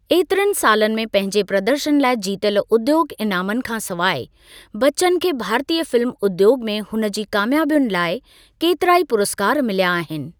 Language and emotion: Sindhi, neutral